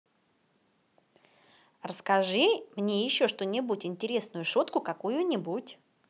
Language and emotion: Russian, positive